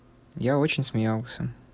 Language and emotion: Russian, neutral